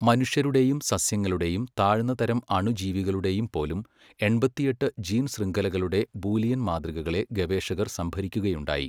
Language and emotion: Malayalam, neutral